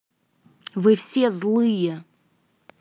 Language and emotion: Russian, angry